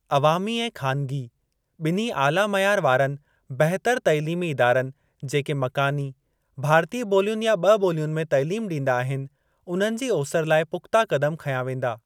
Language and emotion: Sindhi, neutral